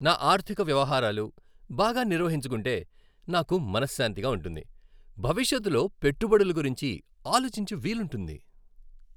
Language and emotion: Telugu, happy